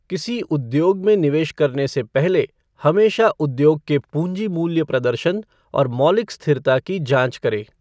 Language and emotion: Hindi, neutral